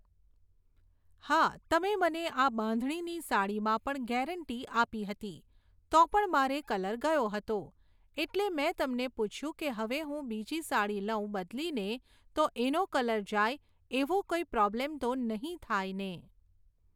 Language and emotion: Gujarati, neutral